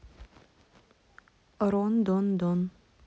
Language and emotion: Russian, neutral